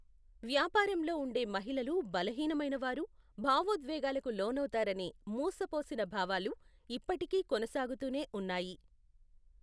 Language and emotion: Telugu, neutral